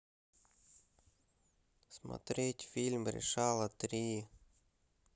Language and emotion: Russian, sad